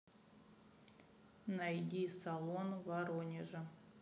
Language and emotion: Russian, neutral